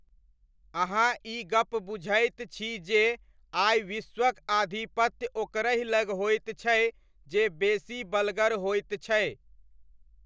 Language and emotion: Maithili, neutral